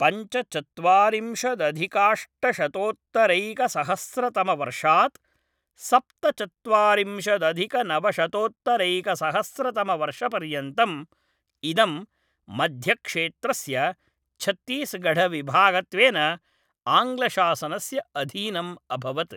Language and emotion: Sanskrit, neutral